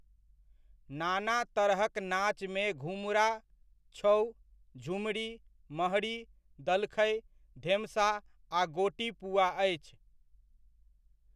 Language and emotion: Maithili, neutral